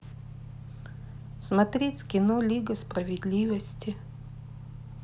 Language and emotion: Russian, neutral